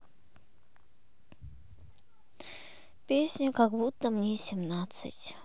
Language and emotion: Russian, sad